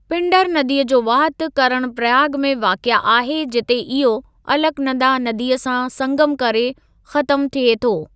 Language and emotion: Sindhi, neutral